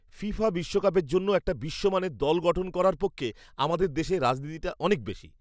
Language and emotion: Bengali, disgusted